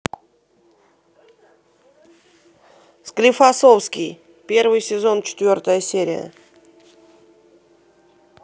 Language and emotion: Russian, positive